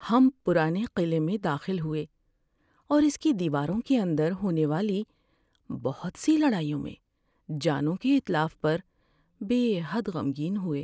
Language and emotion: Urdu, sad